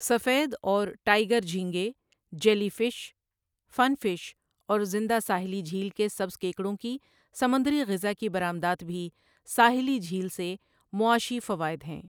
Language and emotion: Urdu, neutral